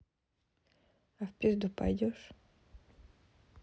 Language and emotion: Russian, neutral